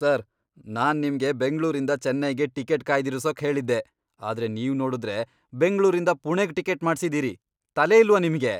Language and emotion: Kannada, angry